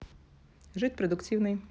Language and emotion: Russian, neutral